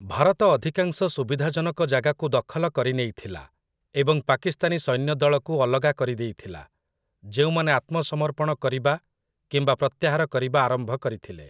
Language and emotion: Odia, neutral